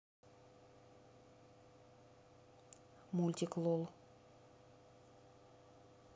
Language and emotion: Russian, neutral